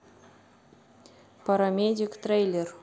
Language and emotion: Russian, neutral